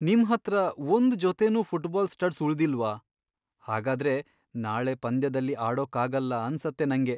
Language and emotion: Kannada, sad